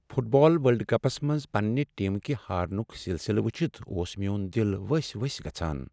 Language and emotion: Kashmiri, sad